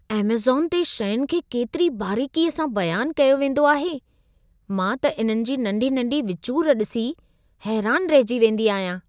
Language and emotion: Sindhi, surprised